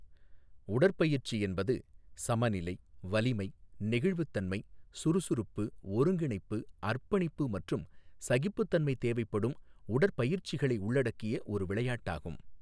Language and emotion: Tamil, neutral